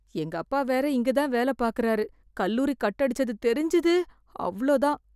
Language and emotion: Tamil, fearful